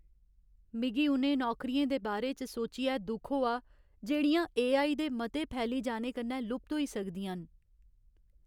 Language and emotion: Dogri, sad